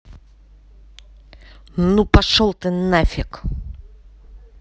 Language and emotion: Russian, angry